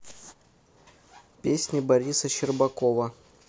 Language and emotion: Russian, neutral